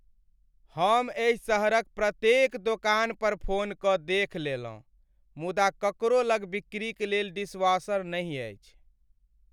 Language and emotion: Maithili, sad